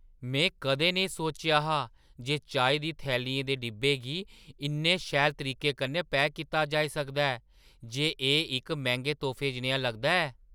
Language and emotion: Dogri, surprised